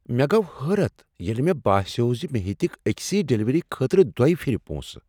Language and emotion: Kashmiri, surprised